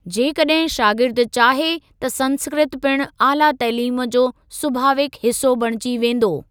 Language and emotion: Sindhi, neutral